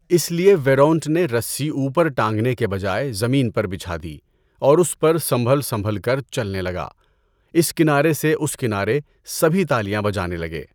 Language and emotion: Urdu, neutral